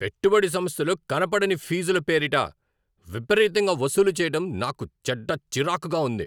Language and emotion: Telugu, angry